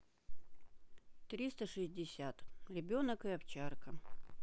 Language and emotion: Russian, neutral